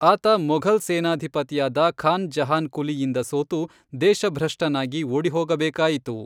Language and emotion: Kannada, neutral